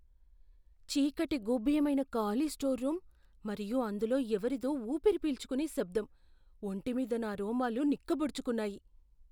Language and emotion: Telugu, fearful